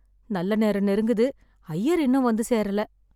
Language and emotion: Tamil, sad